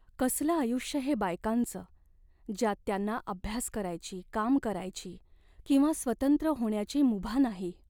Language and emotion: Marathi, sad